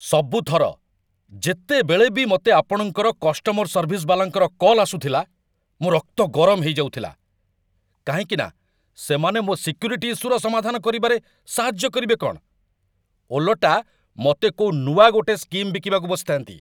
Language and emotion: Odia, angry